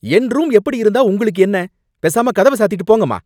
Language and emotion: Tamil, angry